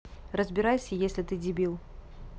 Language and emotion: Russian, angry